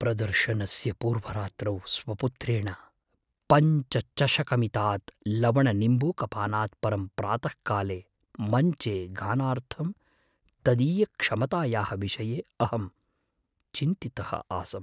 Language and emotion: Sanskrit, fearful